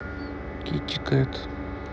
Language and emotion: Russian, neutral